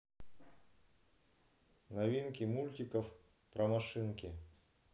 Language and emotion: Russian, neutral